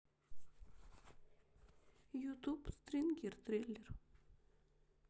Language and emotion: Russian, sad